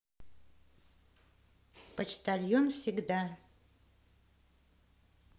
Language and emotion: Russian, positive